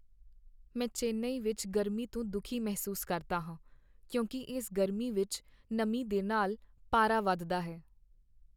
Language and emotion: Punjabi, sad